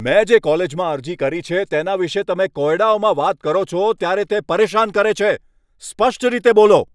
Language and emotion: Gujarati, angry